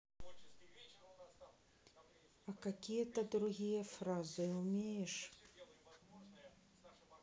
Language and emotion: Russian, neutral